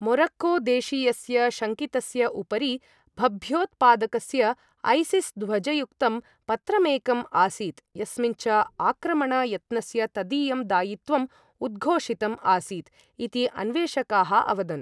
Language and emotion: Sanskrit, neutral